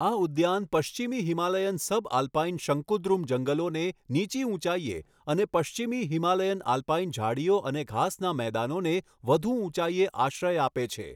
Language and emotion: Gujarati, neutral